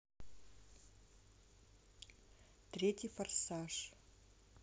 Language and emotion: Russian, neutral